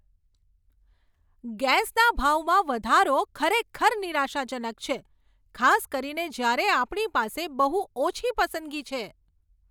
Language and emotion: Gujarati, angry